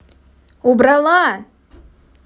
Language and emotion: Russian, angry